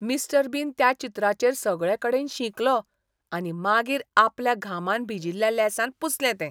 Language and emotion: Goan Konkani, disgusted